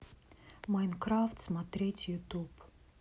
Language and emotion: Russian, neutral